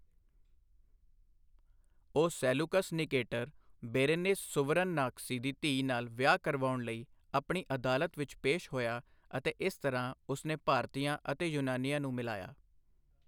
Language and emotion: Punjabi, neutral